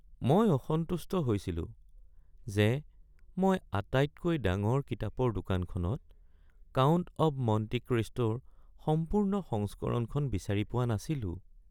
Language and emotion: Assamese, sad